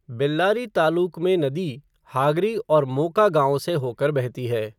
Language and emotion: Hindi, neutral